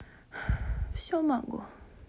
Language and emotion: Russian, sad